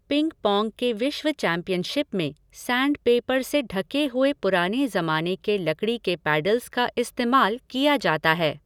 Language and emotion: Hindi, neutral